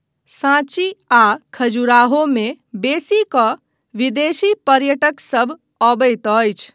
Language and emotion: Maithili, neutral